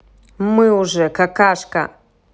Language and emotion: Russian, angry